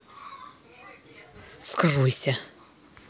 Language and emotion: Russian, angry